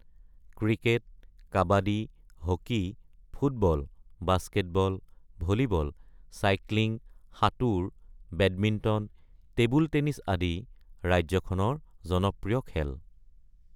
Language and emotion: Assamese, neutral